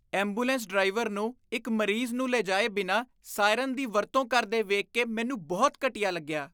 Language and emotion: Punjabi, disgusted